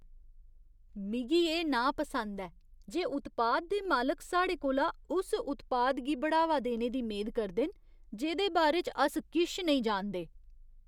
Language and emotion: Dogri, disgusted